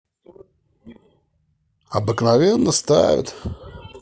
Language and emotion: Russian, neutral